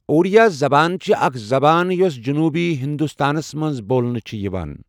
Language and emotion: Kashmiri, neutral